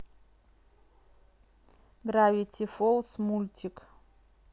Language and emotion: Russian, neutral